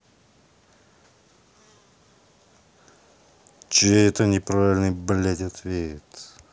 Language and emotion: Russian, angry